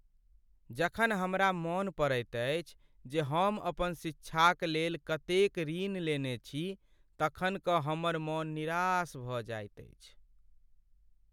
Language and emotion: Maithili, sad